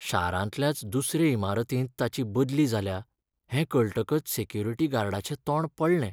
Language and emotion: Goan Konkani, sad